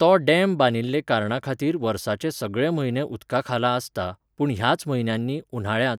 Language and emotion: Goan Konkani, neutral